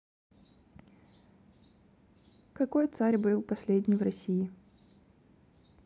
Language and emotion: Russian, neutral